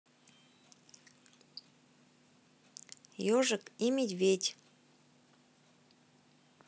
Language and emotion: Russian, neutral